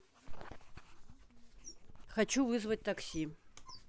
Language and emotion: Russian, neutral